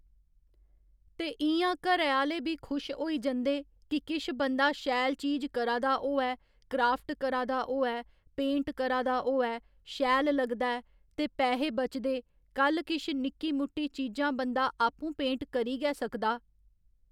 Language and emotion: Dogri, neutral